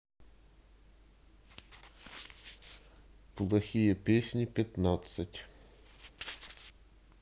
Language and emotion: Russian, neutral